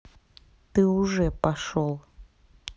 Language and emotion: Russian, angry